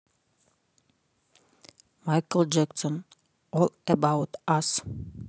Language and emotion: Russian, neutral